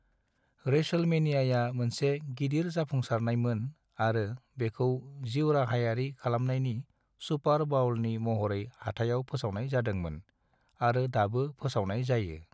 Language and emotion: Bodo, neutral